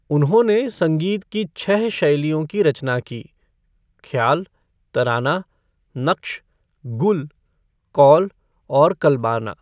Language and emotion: Hindi, neutral